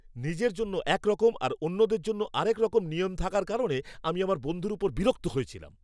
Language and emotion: Bengali, angry